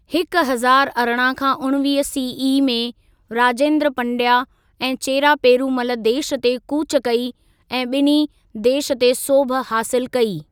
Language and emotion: Sindhi, neutral